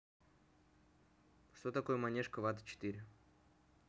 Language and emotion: Russian, neutral